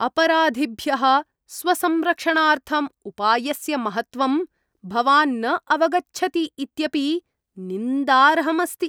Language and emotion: Sanskrit, disgusted